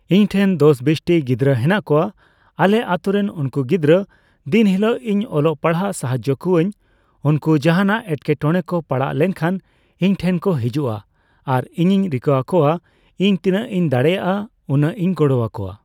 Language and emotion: Santali, neutral